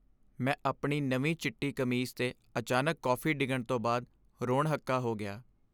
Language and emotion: Punjabi, sad